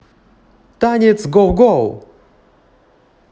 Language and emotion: Russian, positive